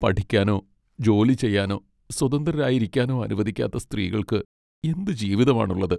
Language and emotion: Malayalam, sad